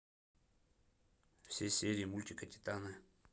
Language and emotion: Russian, neutral